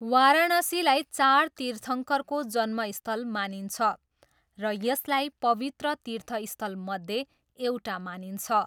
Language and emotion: Nepali, neutral